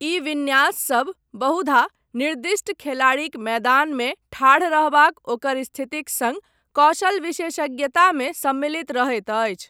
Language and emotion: Maithili, neutral